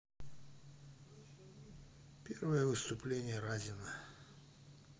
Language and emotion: Russian, neutral